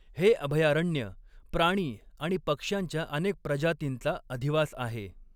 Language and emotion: Marathi, neutral